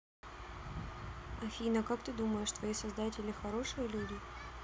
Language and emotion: Russian, neutral